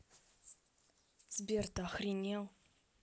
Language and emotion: Russian, angry